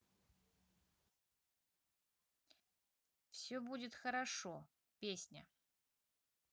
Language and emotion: Russian, neutral